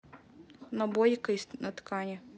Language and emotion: Russian, neutral